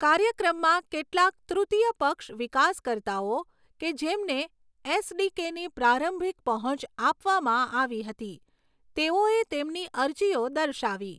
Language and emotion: Gujarati, neutral